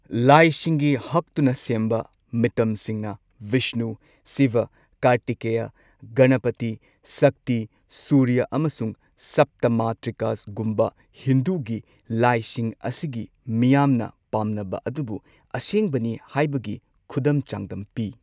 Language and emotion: Manipuri, neutral